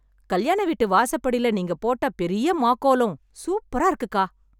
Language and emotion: Tamil, happy